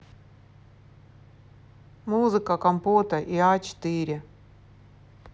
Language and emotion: Russian, neutral